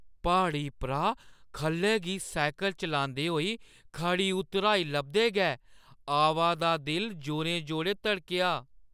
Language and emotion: Dogri, fearful